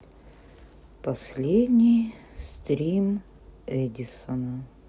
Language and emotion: Russian, sad